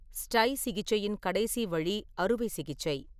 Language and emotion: Tamil, neutral